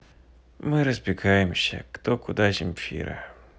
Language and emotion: Russian, sad